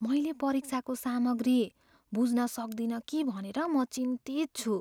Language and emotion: Nepali, fearful